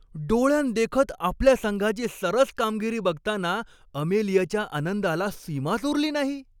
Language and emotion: Marathi, happy